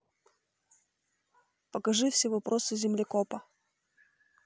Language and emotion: Russian, neutral